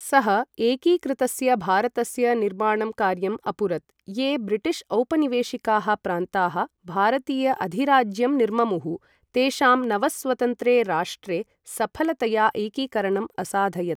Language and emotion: Sanskrit, neutral